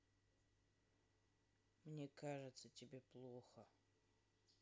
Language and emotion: Russian, sad